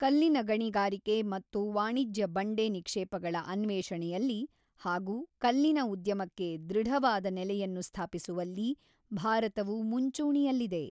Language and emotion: Kannada, neutral